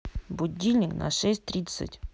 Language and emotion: Russian, neutral